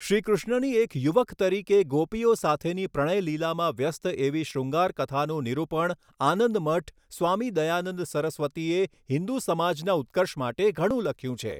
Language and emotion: Gujarati, neutral